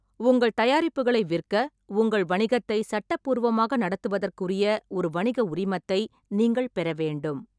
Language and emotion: Tamil, neutral